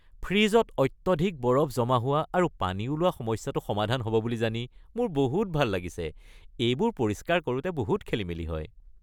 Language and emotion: Assamese, happy